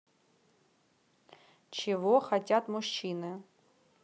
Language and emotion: Russian, neutral